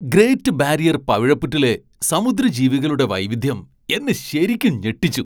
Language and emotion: Malayalam, surprised